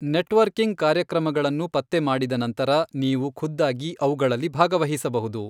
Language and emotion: Kannada, neutral